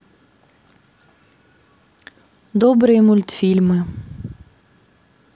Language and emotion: Russian, neutral